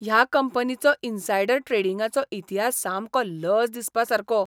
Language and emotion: Goan Konkani, disgusted